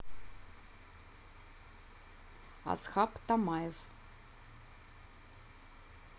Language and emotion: Russian, neutral